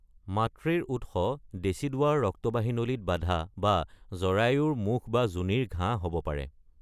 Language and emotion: Assamese, neutral